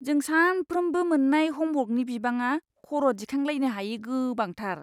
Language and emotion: Bodo, disgusted